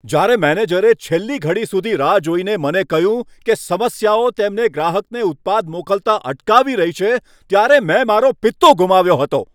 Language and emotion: Gujarati, angry